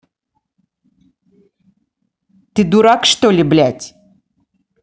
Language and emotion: Russian, angry